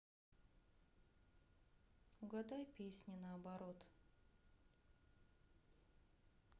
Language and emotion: Russian, sad